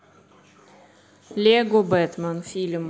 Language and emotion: Russian, neutral